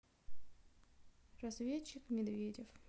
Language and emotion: Russian, sad